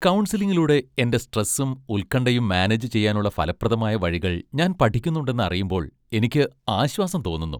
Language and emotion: Malayalam, happy